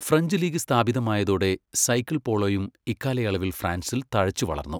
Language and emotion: Malayalam, neutral